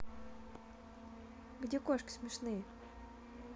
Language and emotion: Russian, neutral